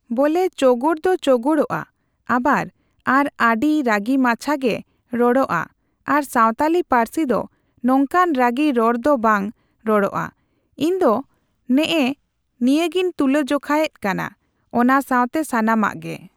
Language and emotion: Santali, neutral